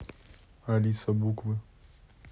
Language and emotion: Russian, neutral